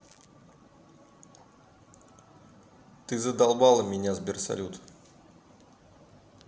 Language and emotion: Russian, angry